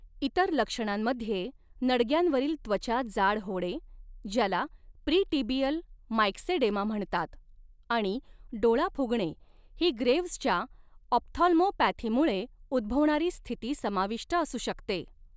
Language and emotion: Marathi, neutral